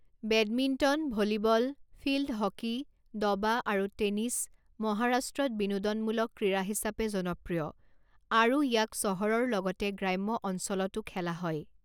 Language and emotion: Assamese, neutral